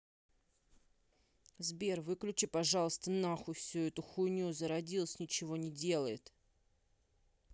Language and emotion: Russian, angry